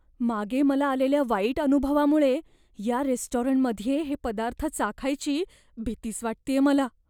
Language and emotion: Marathi, fearful